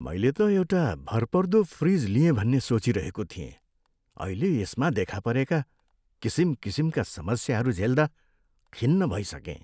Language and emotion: Nepali, sad